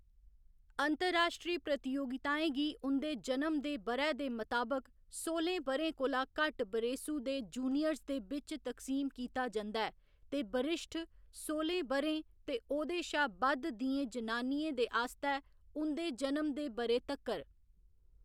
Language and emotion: Dogri, neutral